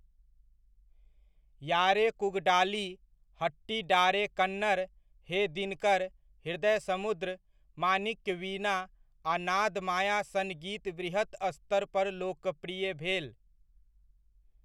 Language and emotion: Maithili, neutral